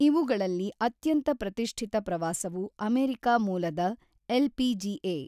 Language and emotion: Kannada, neutral